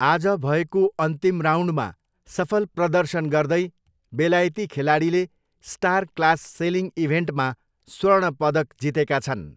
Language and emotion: Nepali, neutral